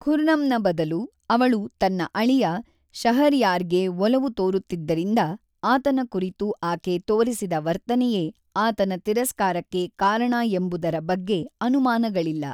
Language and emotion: Kannada, neutral